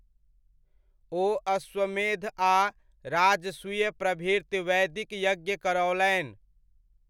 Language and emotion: Maithili, neutral